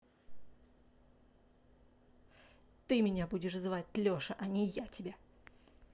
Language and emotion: Russian, angry